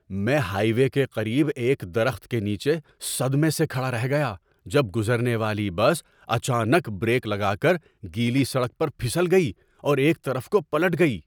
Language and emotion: Urdu, surprised